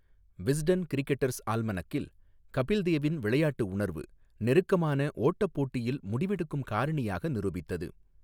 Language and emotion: Tamil, neutral